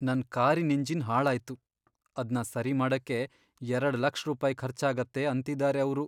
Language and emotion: Kannada, sad